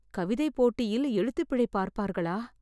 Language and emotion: Tamil, fearful